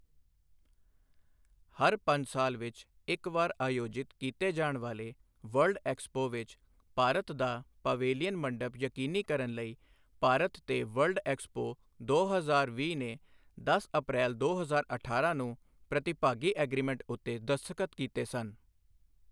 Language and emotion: Punjabi, neutral